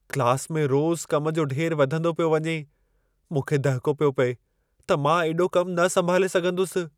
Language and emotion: Sindhi, fearful